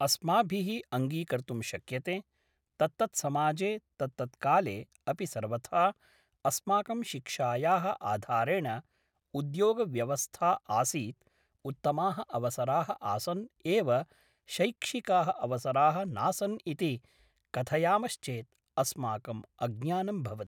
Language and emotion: Sanskrit, neutral